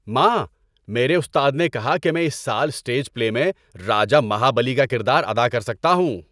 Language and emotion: Urdu, happy